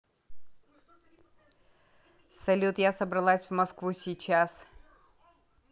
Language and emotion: Russian, neutral